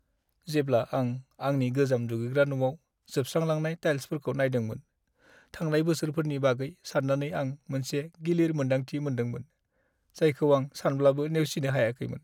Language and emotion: Bodo, sad